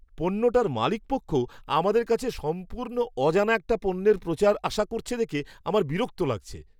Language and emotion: Bengali, disgusted